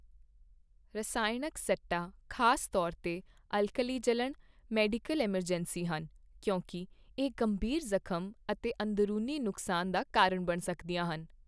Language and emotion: Punjabi, neutral